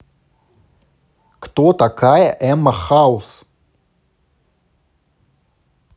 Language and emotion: Russian, neutral